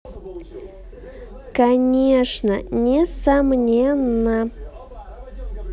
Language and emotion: Russian, positive